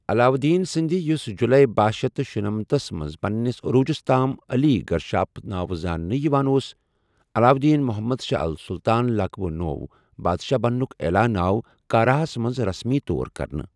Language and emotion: Kashmiri, neutral